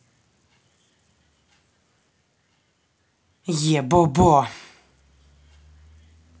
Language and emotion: Russian, angry